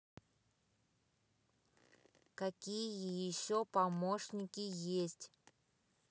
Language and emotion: Russian, neutral